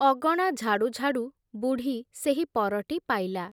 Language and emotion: Odia, neutral